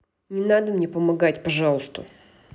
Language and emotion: Russian, angry